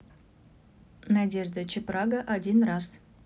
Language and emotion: Russian, neutral